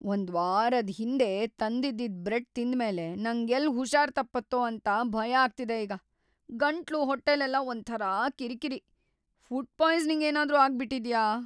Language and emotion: Kannada, fearful